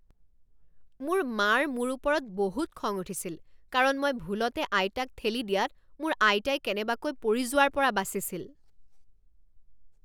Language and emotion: Assamese, angry